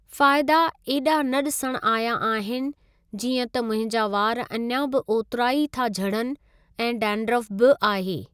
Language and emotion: Sindhi, neutral